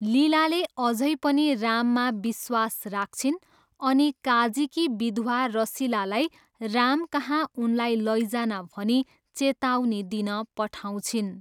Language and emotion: Nepali, neutral